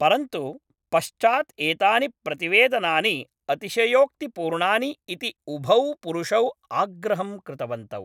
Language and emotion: Sanskrit, neutral